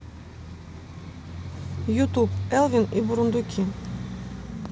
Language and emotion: Russian, neutral